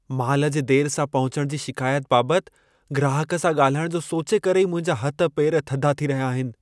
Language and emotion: Sindhi, fearful